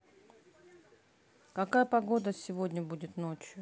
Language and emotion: Russian, neutral